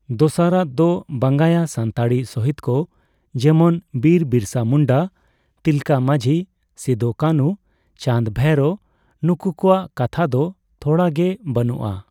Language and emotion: Santali, neutral